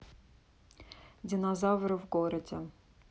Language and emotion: Russian, neutral